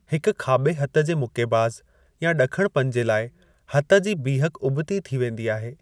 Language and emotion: Sindhi, neutral